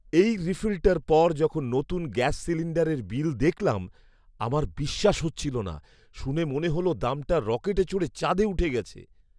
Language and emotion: Bengali, surprised